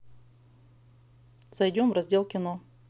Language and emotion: Russian, neutral